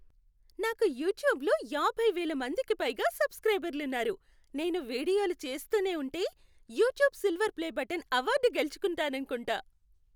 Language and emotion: Telugu, happy